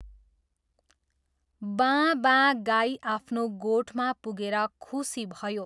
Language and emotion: Nepali, neutral